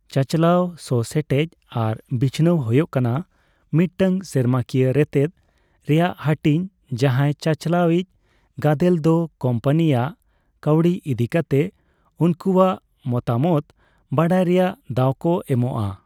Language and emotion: Santali, neutral